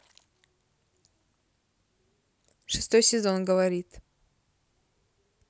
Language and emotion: Russian, neutral